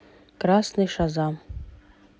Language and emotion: Russian, neutral